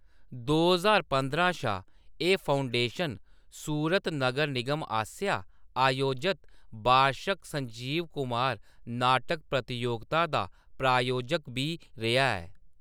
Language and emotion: Dogri, neutral